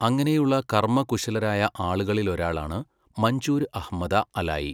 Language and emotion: Malayalam, neutral